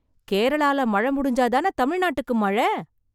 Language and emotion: Tamil, surprised